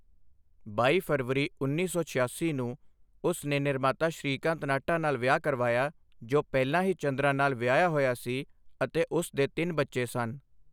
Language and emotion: Punjabi, neutral